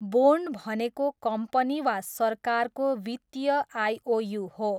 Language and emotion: Nepali, neutral